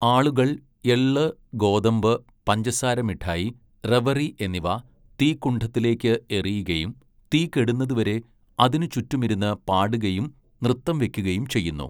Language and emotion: Malayalam, neutral